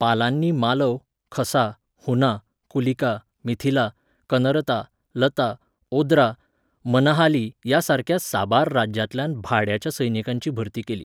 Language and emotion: Goan Konkani, neutral